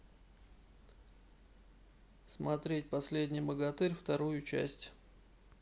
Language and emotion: Russian, neutral